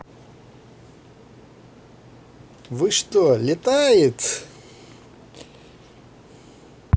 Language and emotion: Russian, positive